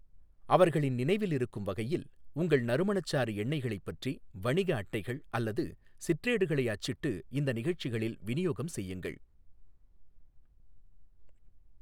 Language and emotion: Tamil, neutral